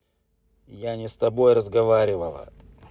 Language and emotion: Russian, angry